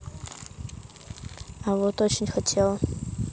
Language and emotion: Russian, neutral